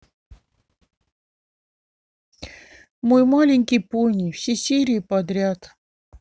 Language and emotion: Russian, sad